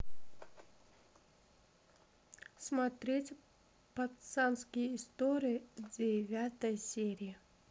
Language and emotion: Russian, neutral